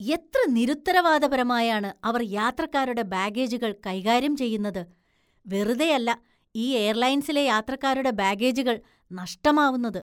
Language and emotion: Malayalam, disgusted